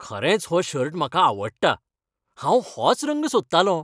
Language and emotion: Goan Konkani, happy